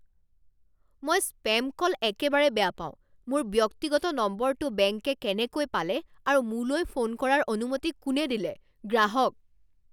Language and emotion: Assamese, angry